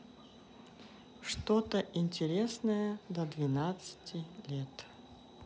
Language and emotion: Russian, neutral